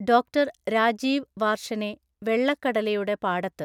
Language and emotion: Malayalam, neutral